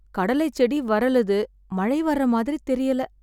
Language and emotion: Tamil, sad